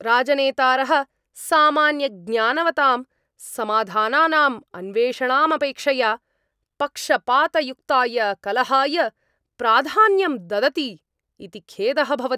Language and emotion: Sanskrit, angry